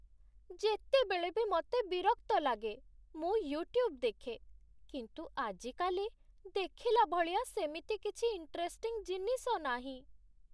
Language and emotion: Odia, sad